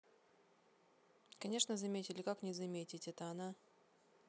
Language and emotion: Russian, neutral